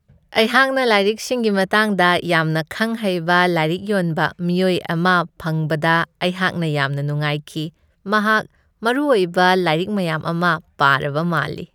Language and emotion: Manipuri, happy